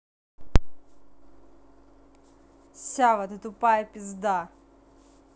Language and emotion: Russian, angry